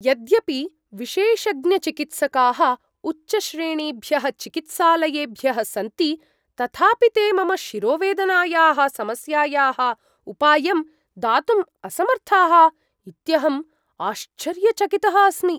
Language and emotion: Sanskrit, surprised